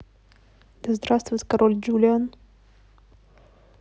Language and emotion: Russian, neutral